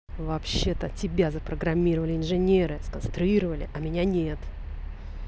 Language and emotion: Russian, angry